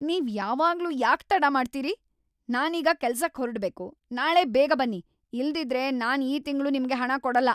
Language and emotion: Kannada, angry